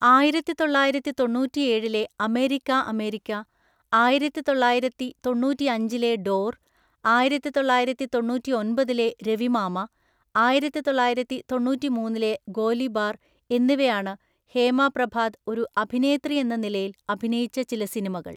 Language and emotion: Malayalam, neutral